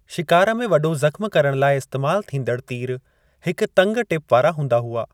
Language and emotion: Sindhi, neutral